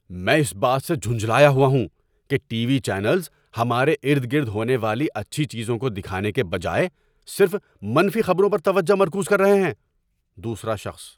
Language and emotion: Urdu, angry